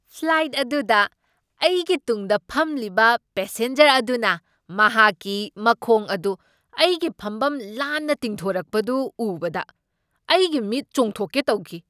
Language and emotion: Manipuri, surprised